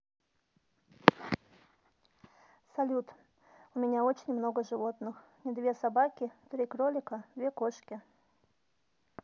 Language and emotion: Russian, neutral